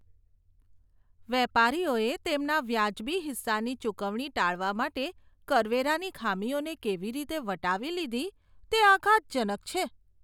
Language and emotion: Gujarati, disgusted